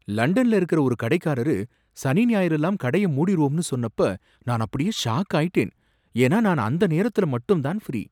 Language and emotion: Tamil, surprised